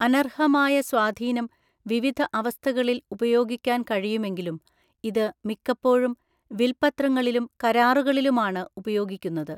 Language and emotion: Malayalam, neutral